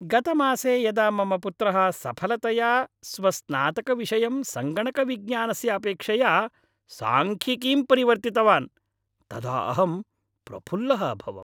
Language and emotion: Sanskrit, happy